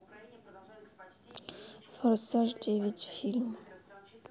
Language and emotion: Russian, neutral